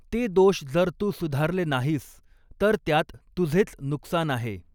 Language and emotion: Marathi, neutral